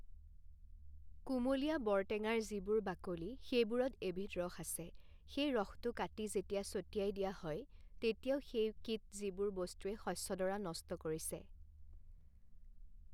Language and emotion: Assamese, neutral